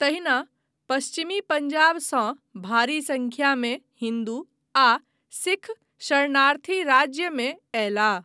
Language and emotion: Maithili, neutral